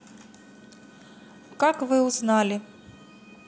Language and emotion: Russian, neutral